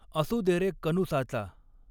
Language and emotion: Marathi, neutral